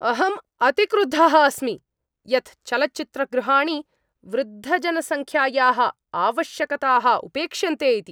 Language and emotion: Sanskrit, angry